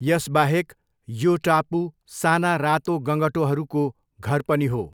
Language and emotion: Nepali, neutral